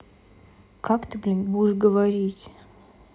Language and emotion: Russian, neutral